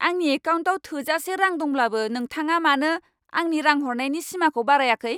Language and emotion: Bodo, angry